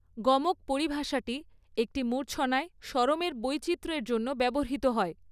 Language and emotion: Bengali, neutral